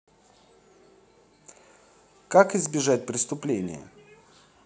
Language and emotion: Russian, positive